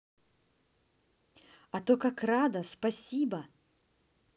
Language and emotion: Russian, positive